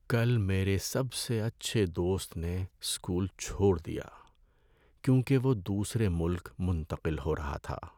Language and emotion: Urdu, sad